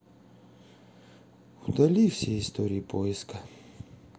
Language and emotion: Russian, sad